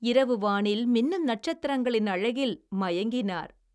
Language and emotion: Tamil, happy